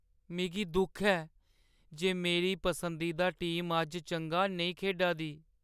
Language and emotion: Dogri, sad